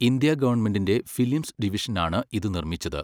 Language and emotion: Malayalam, neutral